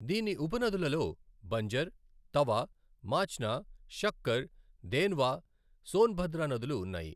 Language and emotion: Telugu, neutral